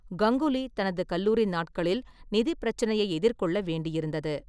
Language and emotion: Tamil, neutral